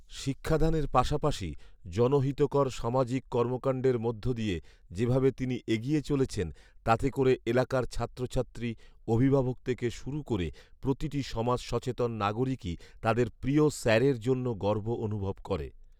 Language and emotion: Bengali, neutral